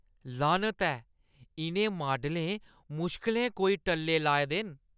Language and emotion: Dogri, disgusted